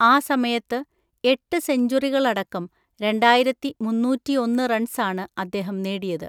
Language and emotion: Malayalam, neutral